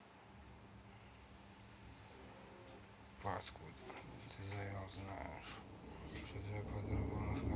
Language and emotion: Russian, neutral